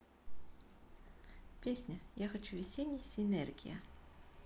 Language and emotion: Russian, neutral